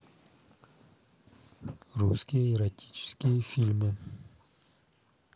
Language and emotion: Russian, neutral